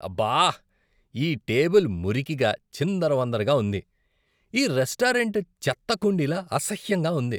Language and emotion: Telugu, disgusted